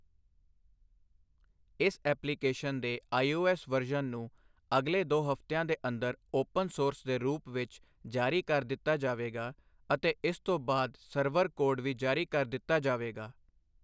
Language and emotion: Punjabi, neutral